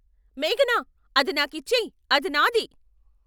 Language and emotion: Telugu, angry